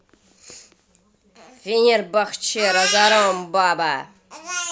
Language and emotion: Russian, angry